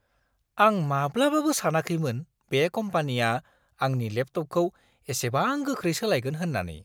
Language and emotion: Bodo, surprised